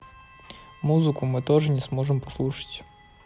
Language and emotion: Russian, neutral